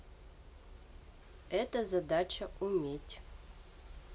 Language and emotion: Russian, neutral